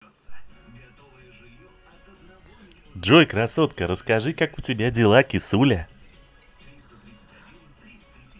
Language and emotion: Russian, positive